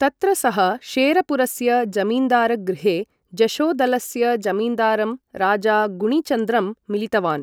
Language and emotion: Sanskrit, neutral